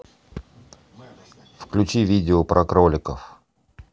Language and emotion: Russian, neutral